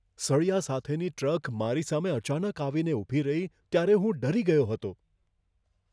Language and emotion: Gujarati, fearful